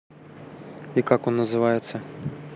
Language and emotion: Russian, neutral